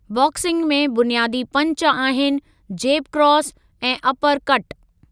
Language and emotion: Sindhi, neutral